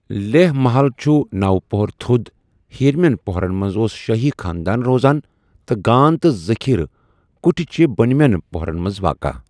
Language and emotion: Kashmiri, neutral